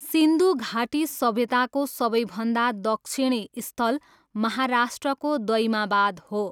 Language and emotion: Nepali, neutral